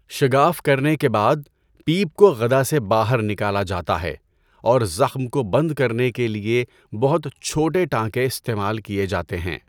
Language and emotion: Urdu, neutral